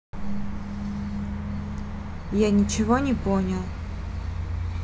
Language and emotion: Russian, neutral